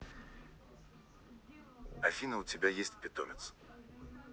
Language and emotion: Russian, neutral